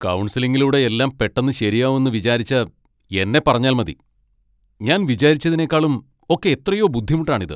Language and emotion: Malayalam, angry